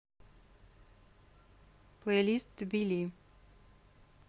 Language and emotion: Russian, neutral